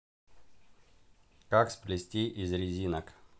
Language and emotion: Russian, neutral